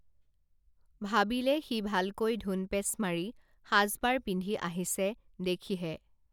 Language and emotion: Assamese, neutral